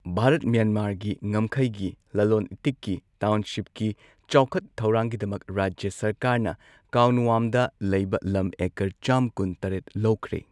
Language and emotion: Manipuri, neutral